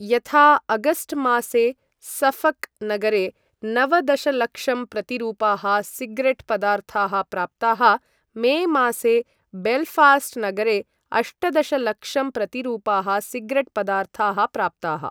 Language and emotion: Sanskrit, neutral